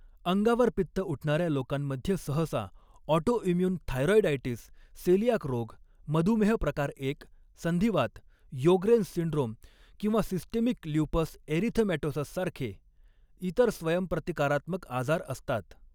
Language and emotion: Marathi, neutral